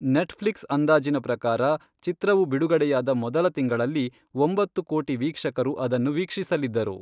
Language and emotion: Kannada, neutral